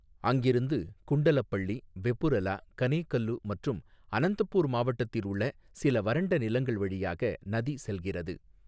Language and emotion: Tamil, neutral